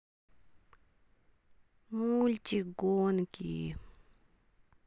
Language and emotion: Russian, sad